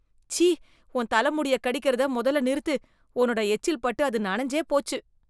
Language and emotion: Tamil, disgusted